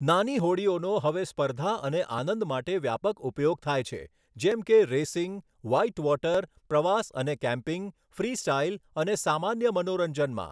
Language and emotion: Gujarati, neutral